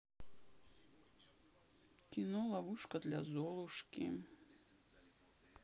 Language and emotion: Russian, sad